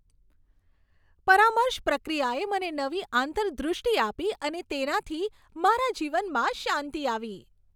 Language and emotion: Gujarati, happy